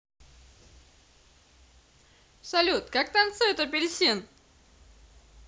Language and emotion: Russian, positive